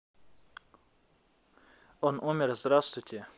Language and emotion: Russian, neutral